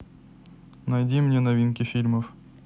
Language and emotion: Russian, neutral